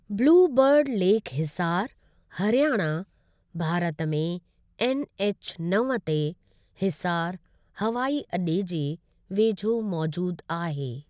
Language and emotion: Sindhi, neutral